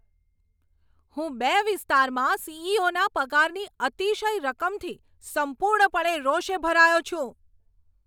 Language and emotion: Gujarati, angry